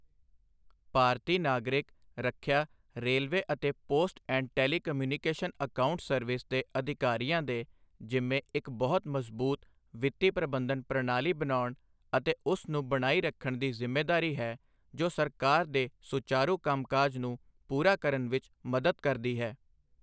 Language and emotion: Punjabi, neutral